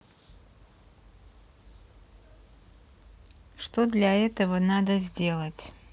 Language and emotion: Russian, neutral